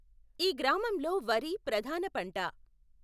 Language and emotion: Telugu, neutral